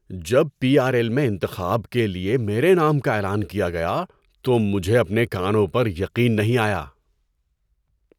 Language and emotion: Urdu, surprised